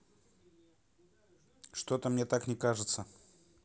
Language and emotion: Russian, neutral